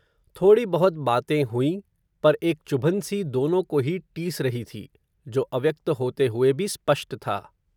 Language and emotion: Hindi, neutral